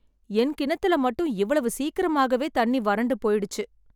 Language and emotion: Tamil, sad